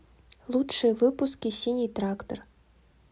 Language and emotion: Russian, neutral